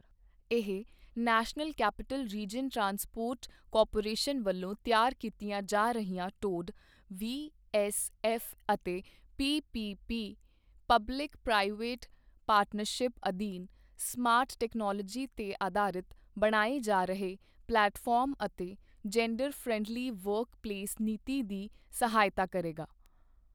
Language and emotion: Punjabi, neutral